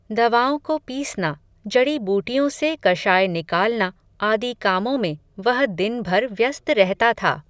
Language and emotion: Hindi, neutral